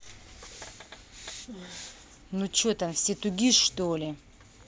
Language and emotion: Russian, angry